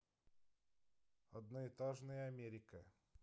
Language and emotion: Russian, neutral